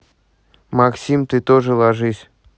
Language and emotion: Russian, angry